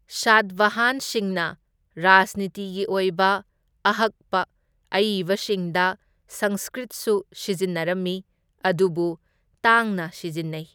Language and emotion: Manipuri, neutral